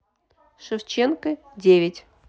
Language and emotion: Russian, neutral